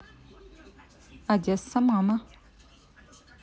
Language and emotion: Russian, neutral